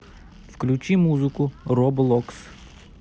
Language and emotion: Russian, neutral